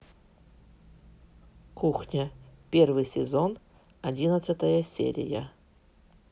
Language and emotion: Russian, neutral